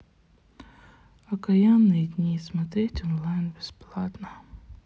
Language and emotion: Russian, sad